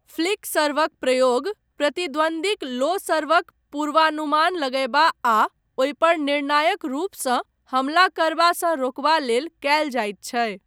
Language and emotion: Maithili, neutral